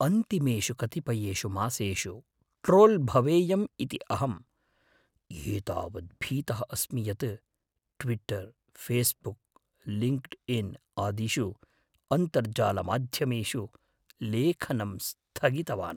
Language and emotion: Sanskrit, fearful